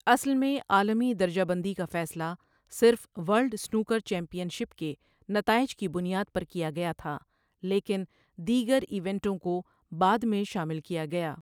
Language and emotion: Urdu, neutral